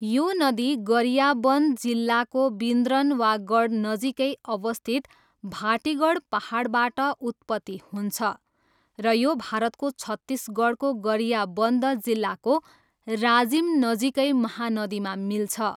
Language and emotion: Nepali, neutral